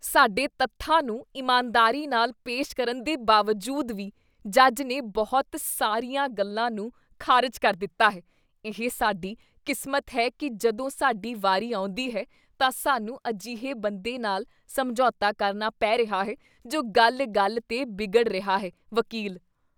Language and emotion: Punjabi, disgusted